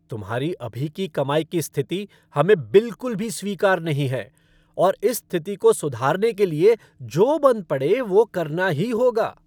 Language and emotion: Hindi, angry